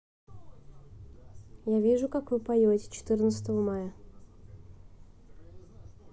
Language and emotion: Russian, neutral